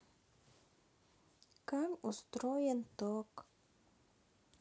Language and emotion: Russian, sad